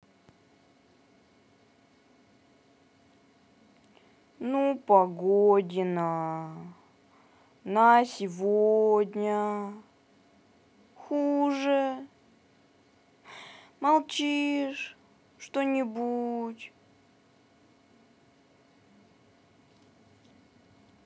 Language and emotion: Russian, sad